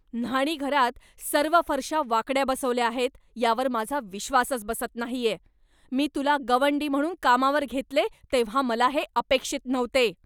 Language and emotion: Marathi, angry